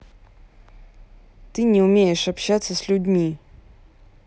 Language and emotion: Russian, angry